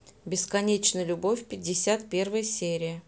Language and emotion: Russian, neutral